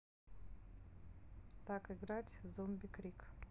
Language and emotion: Russian, neutral